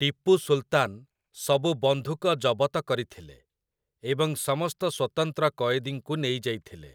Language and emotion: Odia, neutral